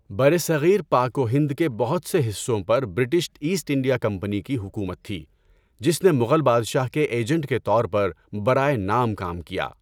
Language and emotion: Urdu, neutral